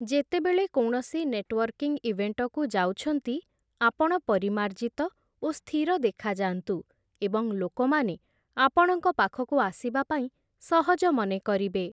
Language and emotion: Odia, neutral